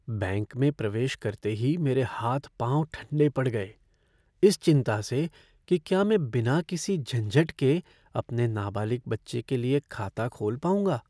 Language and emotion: Hindi, fearful